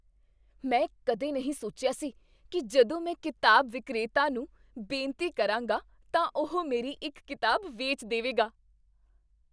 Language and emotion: Punjabi, surprised